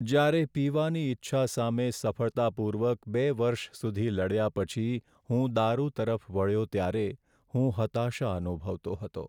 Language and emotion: Gujarati, sad